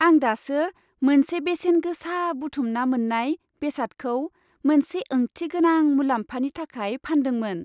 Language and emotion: Bodo, happy